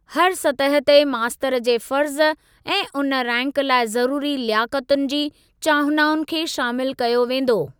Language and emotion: Sindhi, neutral